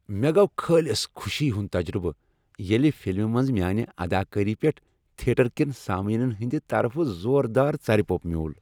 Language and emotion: Kashmiri, happy